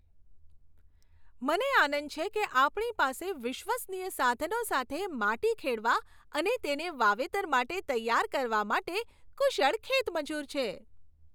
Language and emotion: Gujarati, happy